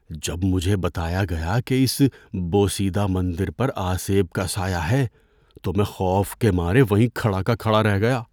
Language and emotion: Urdu, fearful